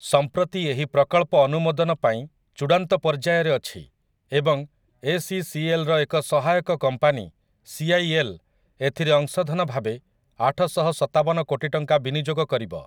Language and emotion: Odia, neutral